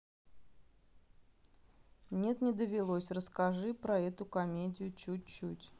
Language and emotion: Russian, neutral